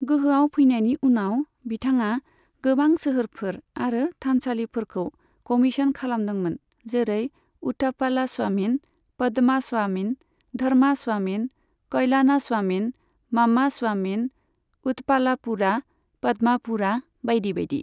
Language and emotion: Bodo, neutral